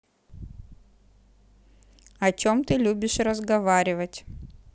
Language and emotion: Russian, neutral